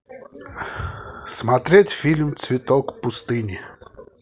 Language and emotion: Russian, positive